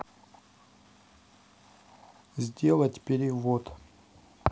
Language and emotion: Russian, neutral